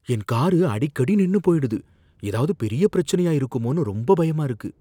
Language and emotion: Tamil, fearful